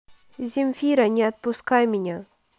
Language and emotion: Russian, neutral